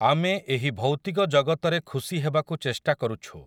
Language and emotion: Odia, neutral